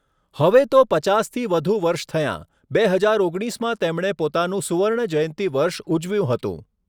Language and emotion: Gujarati, neutral